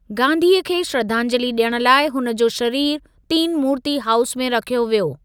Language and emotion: Sindhi, neutral